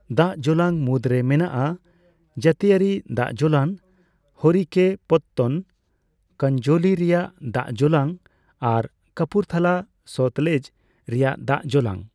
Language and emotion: Santali, neutral